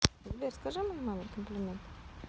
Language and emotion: Russian, neutral